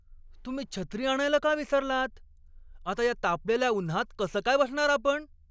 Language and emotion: Marathi, angry